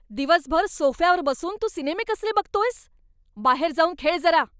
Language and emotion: Marathi, angry